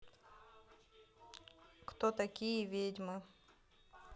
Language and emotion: Russian, neutral